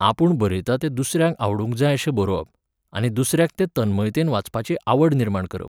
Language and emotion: Goan Konkani, neutral